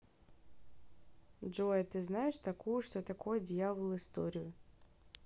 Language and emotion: Russian, neutral